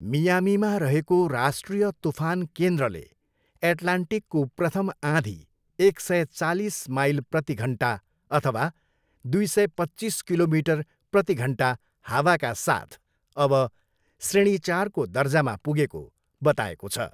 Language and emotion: Nepali, neutral